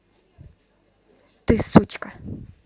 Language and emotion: Russian, angry